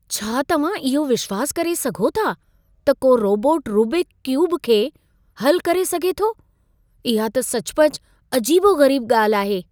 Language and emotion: Sindhi, surprised